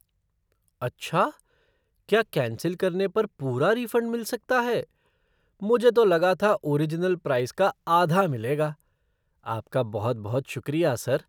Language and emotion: Hindi, surprised